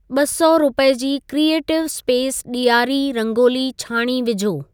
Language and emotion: Sindhi, neutral